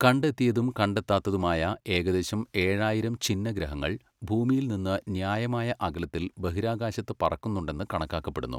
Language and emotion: Malayalam, neutral